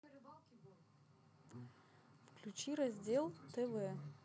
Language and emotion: Russian, neutral